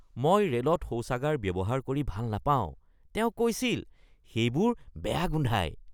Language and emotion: Assamese, disgusted